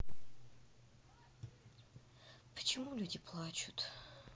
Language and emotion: Russian, sad